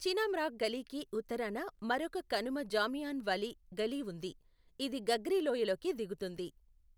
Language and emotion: Telugu, neutral